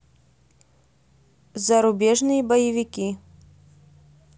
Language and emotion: Russian, neutral